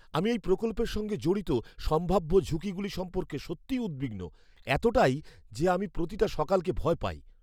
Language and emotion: Bengali, fearful